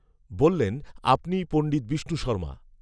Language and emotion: Bengali, neutral